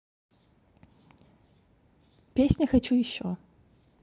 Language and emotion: Russian, neutral